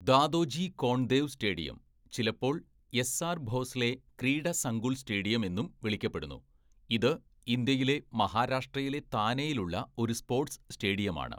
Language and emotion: Malayalam, neutral